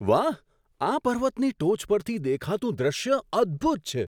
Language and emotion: Gujarati, surprised